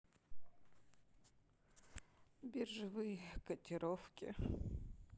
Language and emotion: Russian, sad